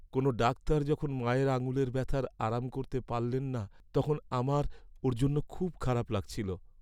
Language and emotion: Bengali, sad